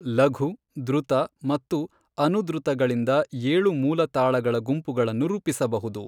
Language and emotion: Kannada, neutral